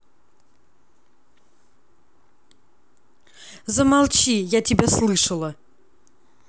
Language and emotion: Russian, angry